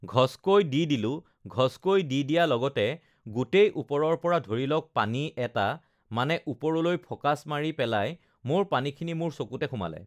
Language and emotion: Assamese, neutral